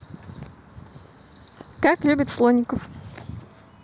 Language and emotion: Russian, neutral